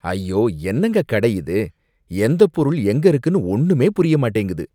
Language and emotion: Tamil, disgusted